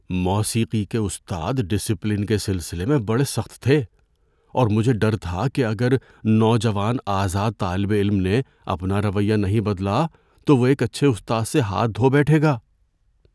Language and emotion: Urdu, fearful